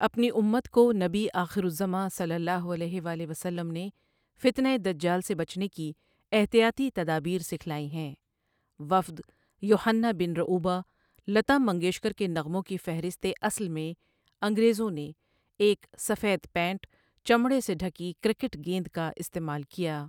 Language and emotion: Urdu, neutral